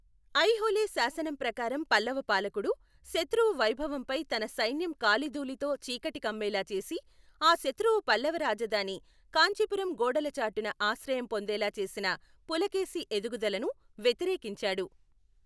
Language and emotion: Telugu, neutral